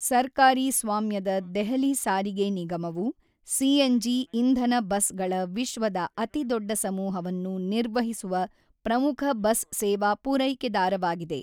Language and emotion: Kannada, neutral